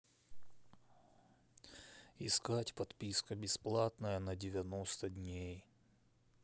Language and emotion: Russian, neutral